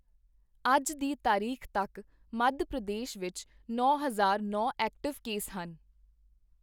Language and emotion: Punjabi, neutral